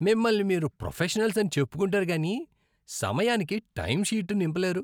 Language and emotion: Telugu, disgusted